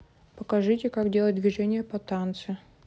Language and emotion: Russian, neutral